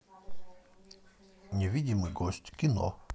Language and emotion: Russian, neutral